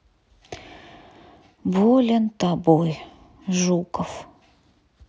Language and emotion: Russian, sad